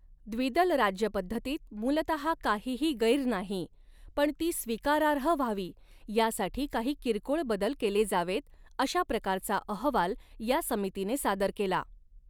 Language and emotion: Marathi, neutral